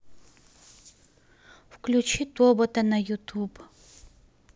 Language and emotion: Russian, neutral